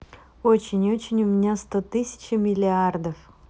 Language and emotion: Russian, positive